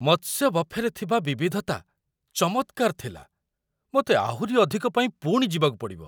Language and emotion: Odia, surprised